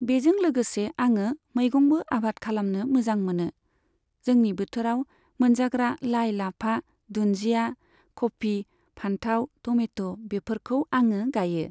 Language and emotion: Bodo, neutral